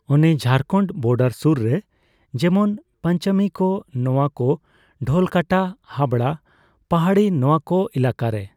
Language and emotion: Santali, neutral